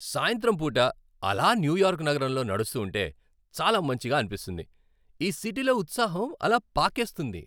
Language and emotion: Telugu, happy